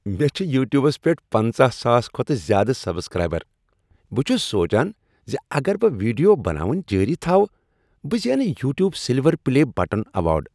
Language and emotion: Kashmiri, happy